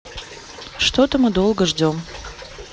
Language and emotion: Russian, neutral